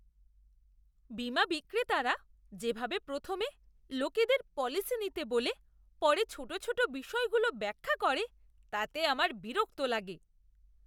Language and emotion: Bengali, disgusted